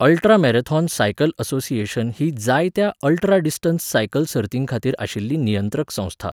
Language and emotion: Goan Konkani, neutral